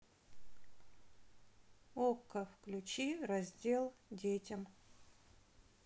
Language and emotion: Russian, neutral